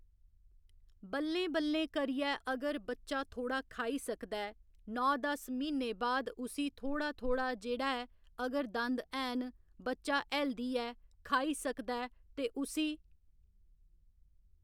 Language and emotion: Dogri, neutral